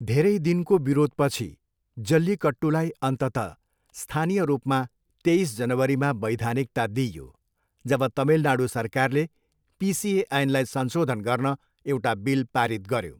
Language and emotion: Nepali, neutral